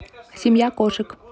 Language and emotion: Russian, neutral